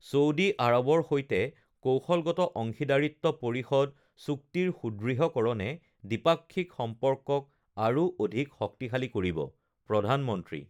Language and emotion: Assamese, neutral